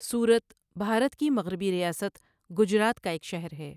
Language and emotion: Urdu, neutral